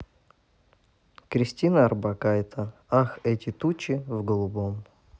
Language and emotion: Russian, neutral